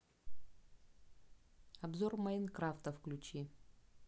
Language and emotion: Russian, neutral